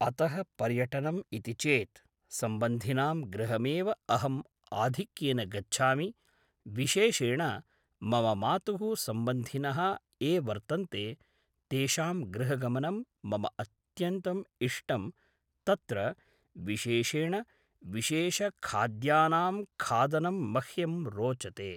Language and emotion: Sanskrit, neutral